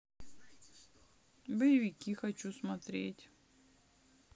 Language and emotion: Russian, neutral